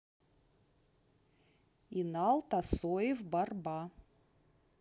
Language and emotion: Russian, neutral